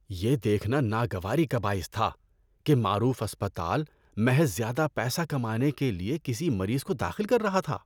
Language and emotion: Urdu, disgusted